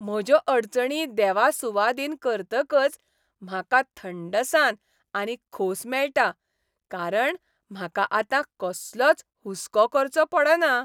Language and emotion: Goan Konkani, happy